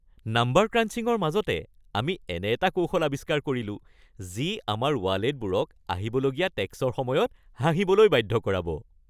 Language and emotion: Assamese, happy